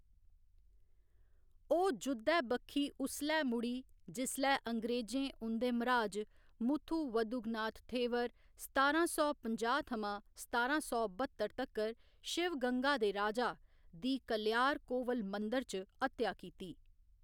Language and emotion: Dogri, neutral